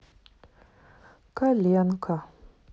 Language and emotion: Russian, sad